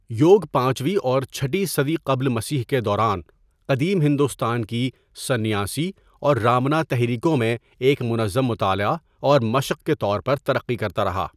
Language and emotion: Urdu, neutral